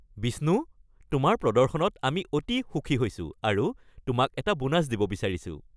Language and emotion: Assamese, happy